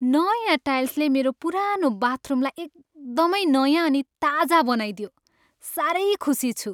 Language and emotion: Nepali, happy